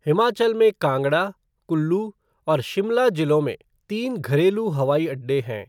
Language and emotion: Hindi, neutral